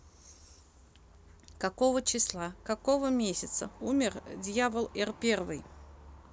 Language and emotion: Russian, neutral